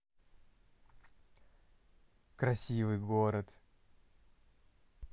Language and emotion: Russian, positive